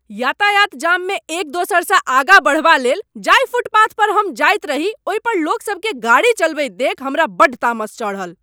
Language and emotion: Maithili, angry